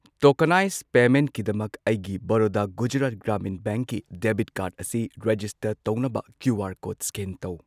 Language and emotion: Manipuri, neutral